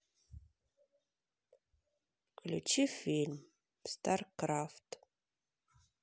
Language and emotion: Russian, sad